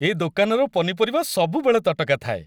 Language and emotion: Odia, happy